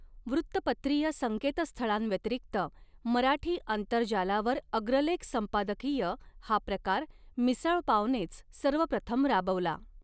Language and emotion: Marathi, neutral